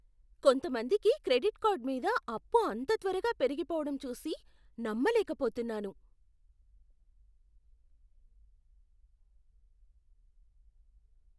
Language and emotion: Telugu, surprised